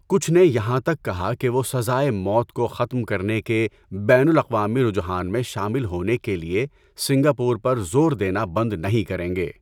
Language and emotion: Urdu, neutral